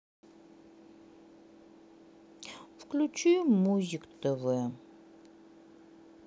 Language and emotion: Russian, sad